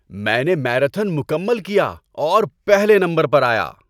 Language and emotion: Urdu, happy